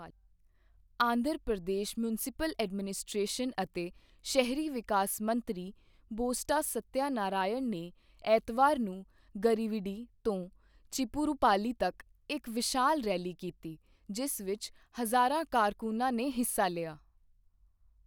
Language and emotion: Punjabi, neutral